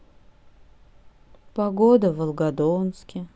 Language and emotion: Russian, sad